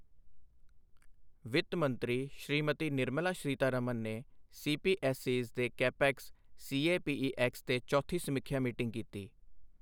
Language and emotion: Punjabi, neutral